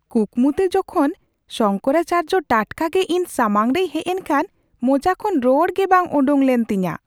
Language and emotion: Santali, surprised